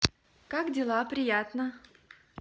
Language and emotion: Russian, positive